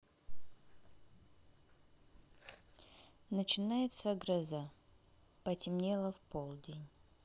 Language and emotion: Russian, neutral